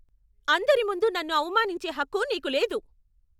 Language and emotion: Telugu, angry